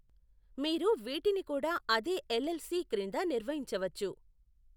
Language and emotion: Telugu, neutral